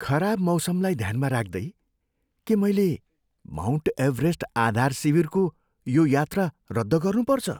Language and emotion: Nepali, fearful